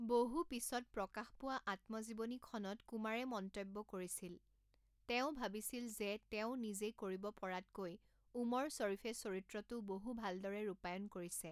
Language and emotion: Assamese, neutral